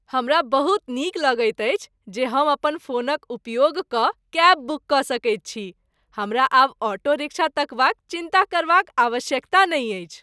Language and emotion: Maithili, happy